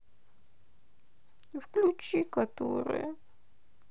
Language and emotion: Russian, sad